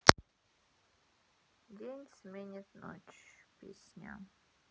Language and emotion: Russian, sad